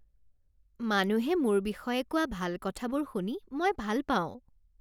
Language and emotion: Assamese, happy